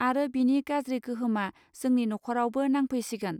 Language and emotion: Bodo, neutral